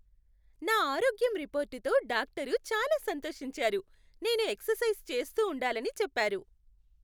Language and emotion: Telugu, happy